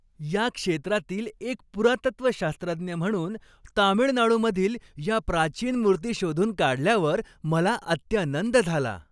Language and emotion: Marathi, happy